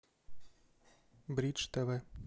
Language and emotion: Russian, neutral